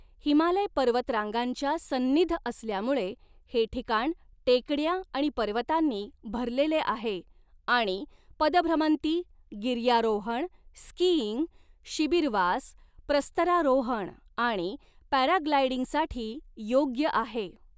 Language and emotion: Marathi, neutral